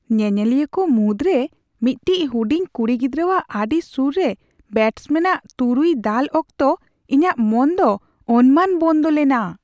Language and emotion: Santali, surprised